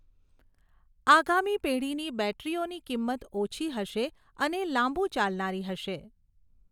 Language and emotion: Gujarati, neutral